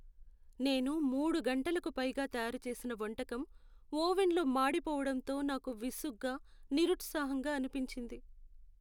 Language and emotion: Telugu, sad